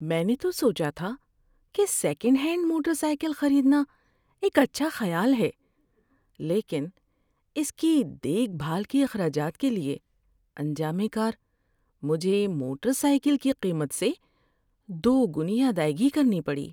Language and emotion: Urdu, sad